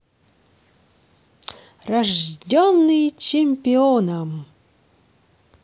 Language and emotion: Russian, positive